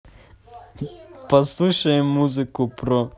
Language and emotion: Russian, positive